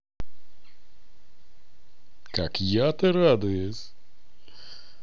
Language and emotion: Russian, positive